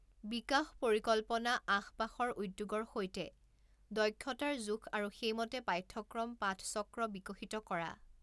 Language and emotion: Assamese, neutral